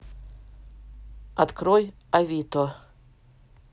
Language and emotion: Russian, neutral